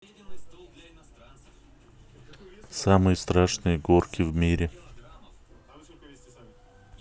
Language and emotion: Russian, neutral